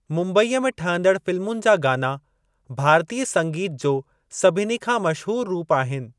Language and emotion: Sindhi, neutral